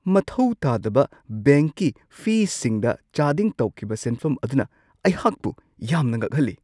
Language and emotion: Manipuri, surprised